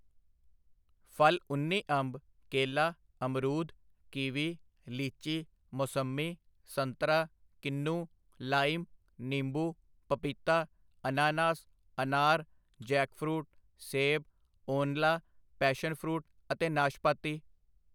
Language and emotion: Punjabi, neutral